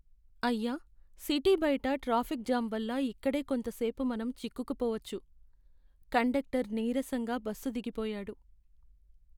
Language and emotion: Telugu, sad